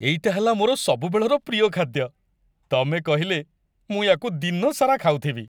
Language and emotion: Odia, happy